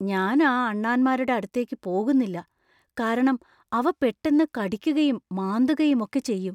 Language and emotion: Malayalam, fearful